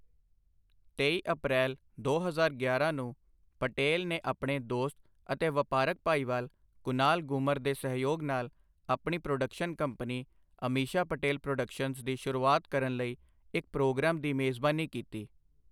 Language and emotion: Punjabi, neutral